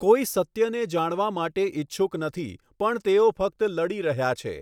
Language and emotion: Gujarati, neutral